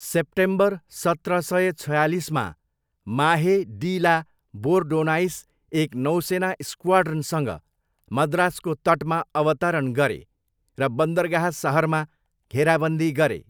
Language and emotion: Nepali, neutral